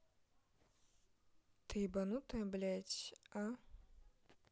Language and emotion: Russian, neutral